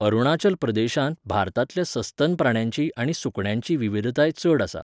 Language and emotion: Goan Konkani, neutral